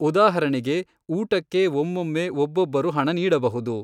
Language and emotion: Kannada, neutral